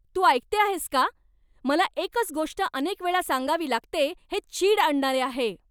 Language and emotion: Marathi, angry